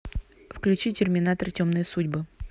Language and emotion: Russian, neutral